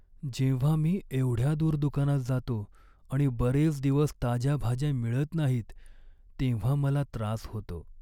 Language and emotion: Marathi, sad